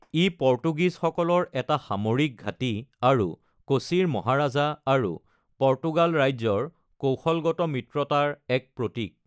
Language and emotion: Assamese, neutral